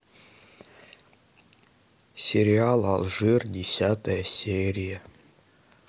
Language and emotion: Russian, sad